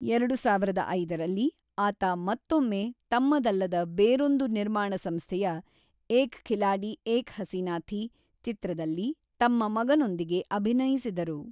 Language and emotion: Kannada, neutral